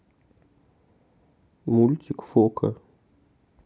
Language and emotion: Russian, neutral